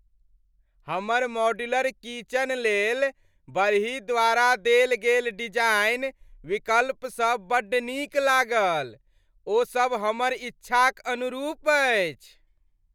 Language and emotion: Maithili, happy